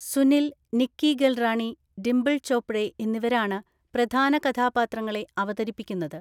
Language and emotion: Malayalam, neutral